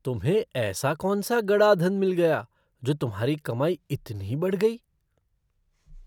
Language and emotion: Hindi, surprised